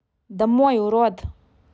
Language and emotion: Russian, angry